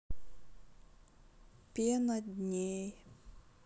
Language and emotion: Russian, sad